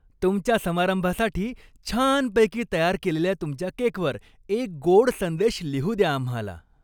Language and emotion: Marathi, happy